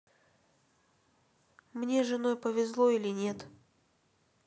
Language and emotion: Russian, neutral